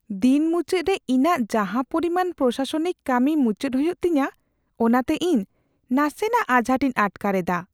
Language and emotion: Santali, fearful